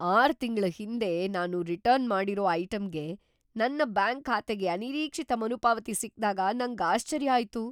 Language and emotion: Kannada, surprised